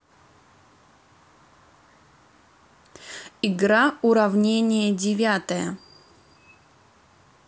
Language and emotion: Russian, neutral